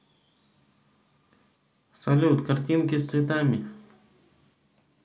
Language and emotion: Russian, neutral